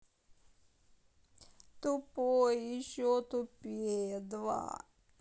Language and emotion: Russian, sad